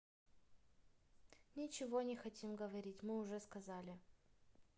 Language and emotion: Russian, sad